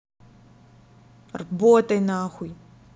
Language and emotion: Russian, angry